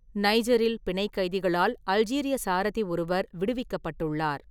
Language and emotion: Tamil, neutral